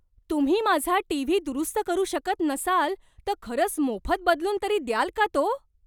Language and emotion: Marathi, surprised